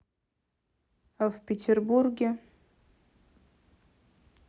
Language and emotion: Russian, neutral